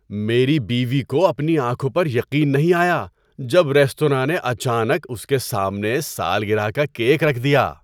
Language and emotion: Urdu, surprised